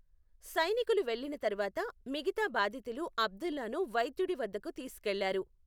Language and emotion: Telugu, neutral